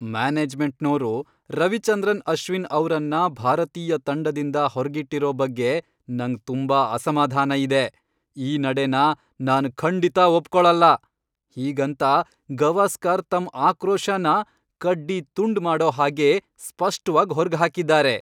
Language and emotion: Kannada, angry